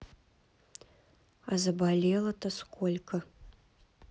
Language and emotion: Russian, neutral